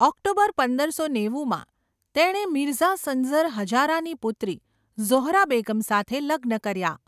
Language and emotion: Gujarati, neutral